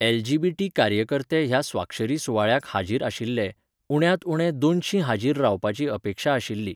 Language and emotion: Goan Konkani, neutral